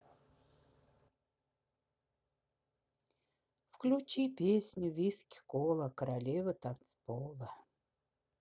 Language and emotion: Russian, sad